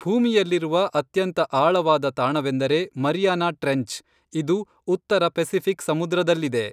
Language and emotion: Kannada, neutral